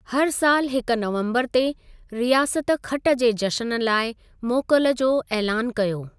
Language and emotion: Sindhi, neutral